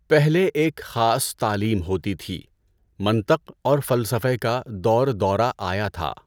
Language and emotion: Urdu, neutral